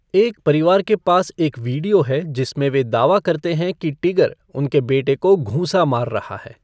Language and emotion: Hindi, neutral